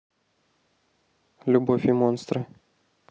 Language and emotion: Russian, neutral